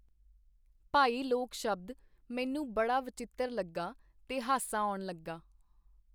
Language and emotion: Punjabi, neutral